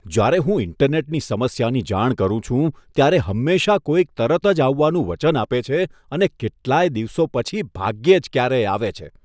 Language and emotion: Gujarati, disgusted